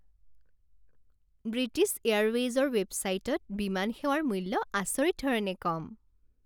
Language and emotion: Assamese, happy